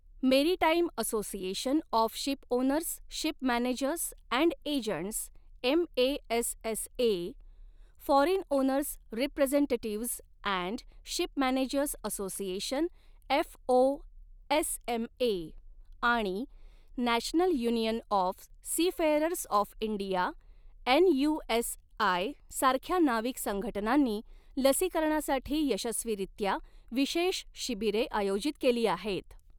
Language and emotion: Marathi, neutral